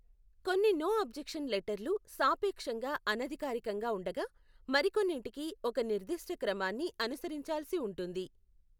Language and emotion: Telugu, neutral